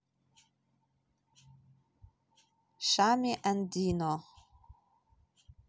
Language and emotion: Russian, neutral